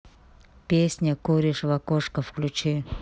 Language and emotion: Russian, neutral